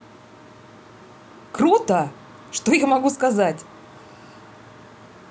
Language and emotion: Russian, positive